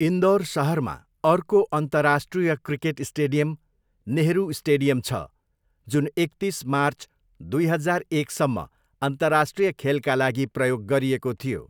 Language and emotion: Nepali, neutral